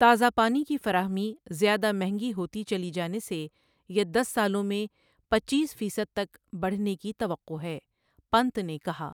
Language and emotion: Urdu, neutral